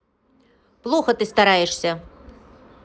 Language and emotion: Russian, neutral